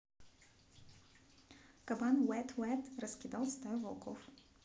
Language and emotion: Russian, neutral